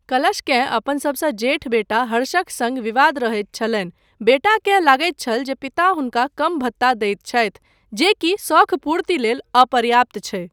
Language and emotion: Maithili, neutral